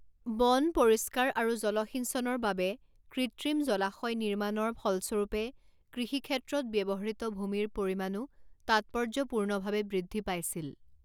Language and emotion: Assamese, neutral